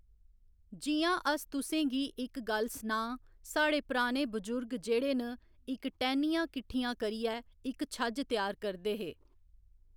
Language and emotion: Dogri, neutral